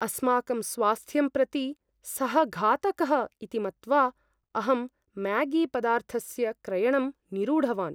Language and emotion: Sanskrit, fearful